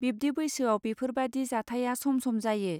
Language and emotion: Bodo, neutral